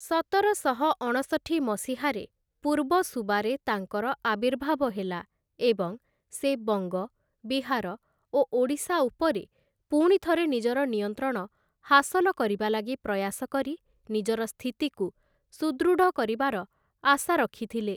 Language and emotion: Odia, neutral